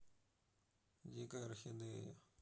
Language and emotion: Russian, neutral